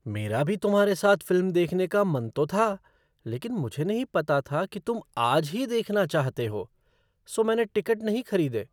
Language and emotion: Hindi, surprised